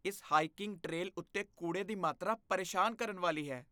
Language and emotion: Punjabi, disgusted